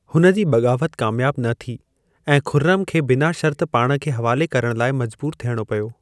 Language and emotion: Sindhi, neutral